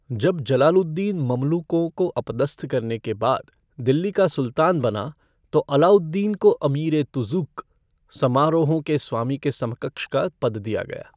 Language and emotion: Hindi, neutral